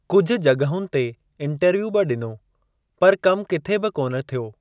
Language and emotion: Sindhi, neutral